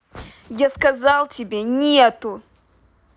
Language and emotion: Russian, angry